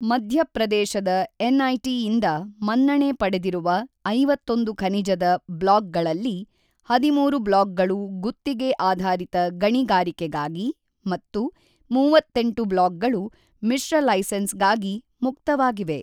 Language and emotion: Kannada, neutral